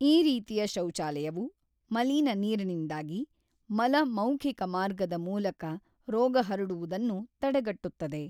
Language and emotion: Kannada, neutral